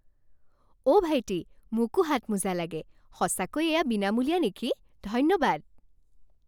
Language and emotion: Assamese, happy